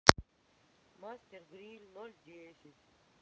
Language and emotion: Russian, neutral